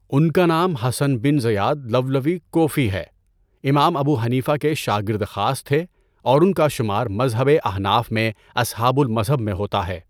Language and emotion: Urdu, neutral